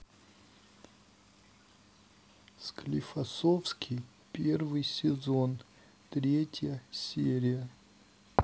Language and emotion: Russian, sad